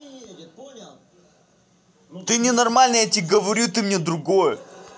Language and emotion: Russian, angry